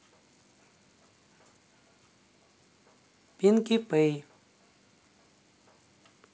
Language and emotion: Russian, neutral